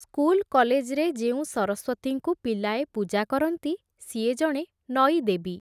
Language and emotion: Odia, neutral